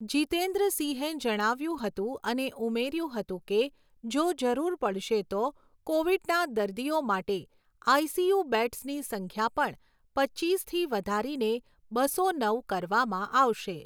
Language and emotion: Gujarati, neutral